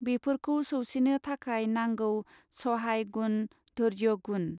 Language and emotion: Bodo, neutral